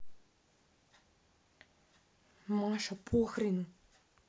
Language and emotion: Russian, angry